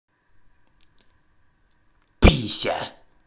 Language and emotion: Russian, neutral